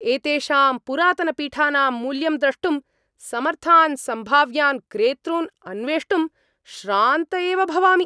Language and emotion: Sanskrit, angry